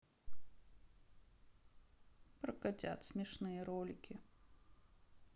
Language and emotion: Russian, sad